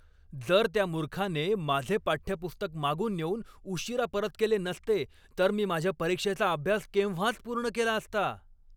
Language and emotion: Marathi, angry